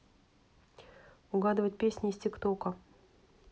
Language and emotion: Russian, neutral